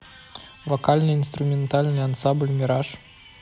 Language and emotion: Russian, neutral